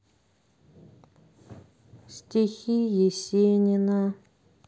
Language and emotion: Russian, sad